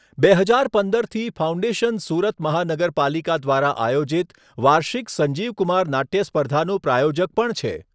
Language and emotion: Gujarati, neutral